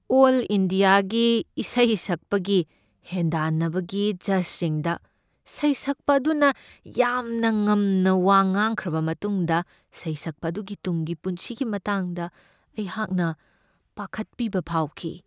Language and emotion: Manipuri, fearful